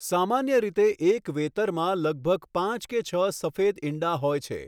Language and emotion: Gujarati, neutral